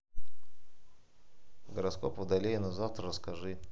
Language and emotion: Russian, neutral